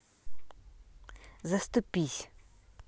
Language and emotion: Russian, neutral